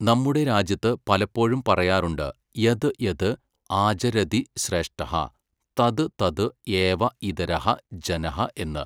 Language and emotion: Malayalam, neutral